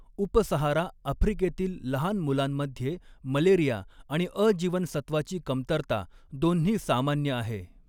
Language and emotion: Marathi, neutral